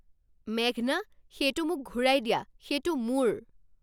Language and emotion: Assamese, angry